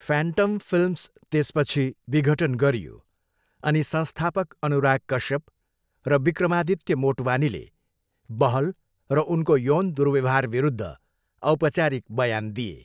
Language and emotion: Nepali, neutral